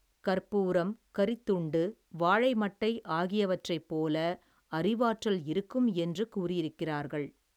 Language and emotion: Tamil, neutral